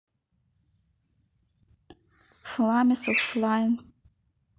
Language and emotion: Russian, neutral